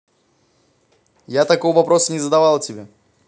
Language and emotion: Russian, neutral